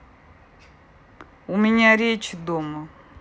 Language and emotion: Russian, neutral